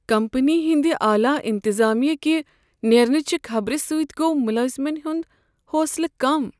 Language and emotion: Kashmiri, sad